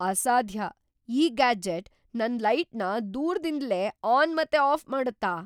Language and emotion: Kannada, surprised